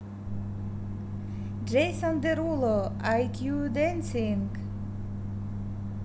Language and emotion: Russian, positive